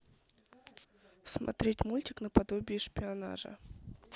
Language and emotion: Russian, neutral